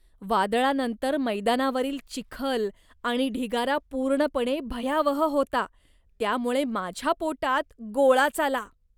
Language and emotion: Marathi, disgusted